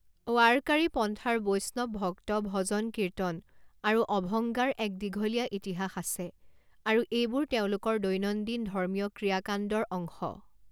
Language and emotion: Assamese, neutral